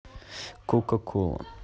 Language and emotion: Russian, neutral